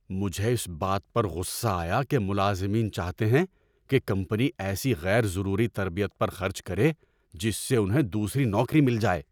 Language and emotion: Urdu, angry